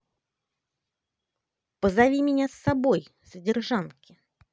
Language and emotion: Russian, positive